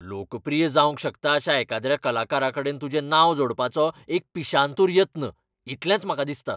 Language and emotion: Goan Konkani, angry